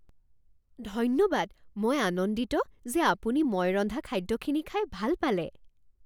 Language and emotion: Assamese, surprised